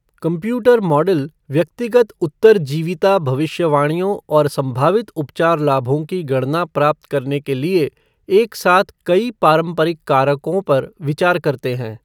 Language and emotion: Hindi, neutral